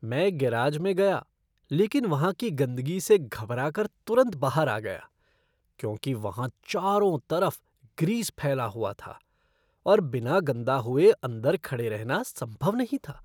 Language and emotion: Hindi, disgusted